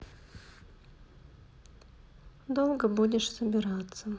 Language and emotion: Russian, sad